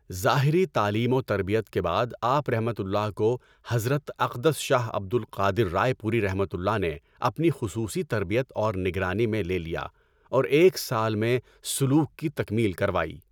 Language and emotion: Urdu, neutral